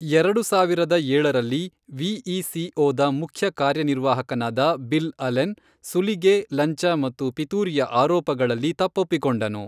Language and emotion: Kannada, neutral